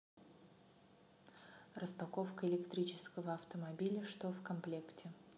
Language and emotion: Russian, neutral